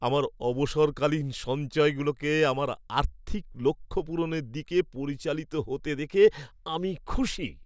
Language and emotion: Bengali, happy